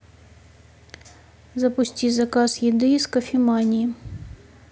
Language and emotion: Russian, neutral